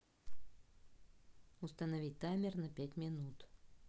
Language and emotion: Russian, neutral